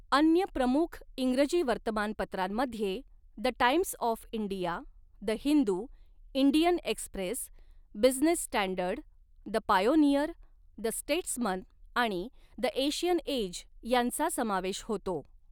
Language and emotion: Marathi, neutral